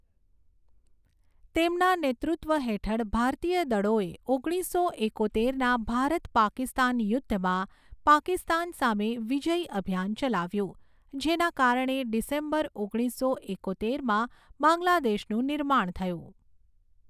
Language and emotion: Gujarati, neutral